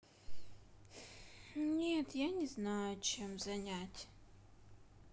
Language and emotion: Russian, sad